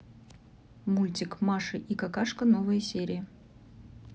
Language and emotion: Russian, neutral